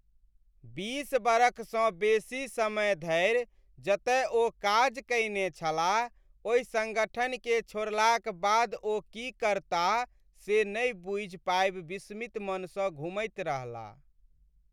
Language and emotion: Maithili, sad